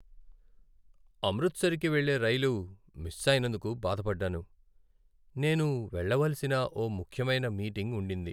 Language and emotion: Telugu, sad